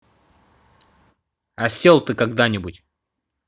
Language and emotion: Russian, angry